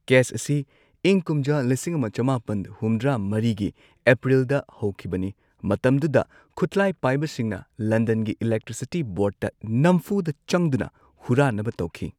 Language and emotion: Manipuri, neutral